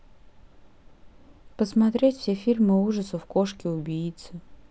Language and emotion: Russian, neutral